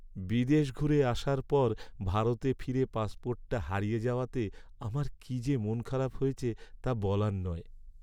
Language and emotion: Bengali, sad